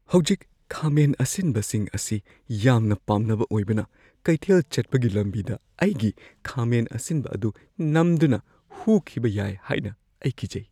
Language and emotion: Manipuri, fearful